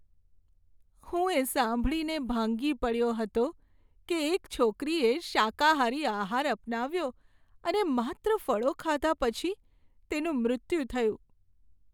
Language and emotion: Gujarati, sad